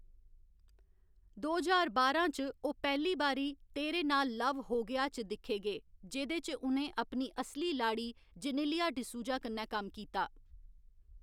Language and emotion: Dogri, neutral